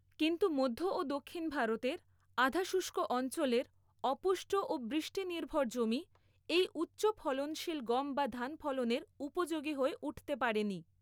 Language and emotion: Bengali, neutral